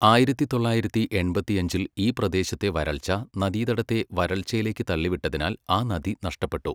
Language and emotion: Malayalam, neutral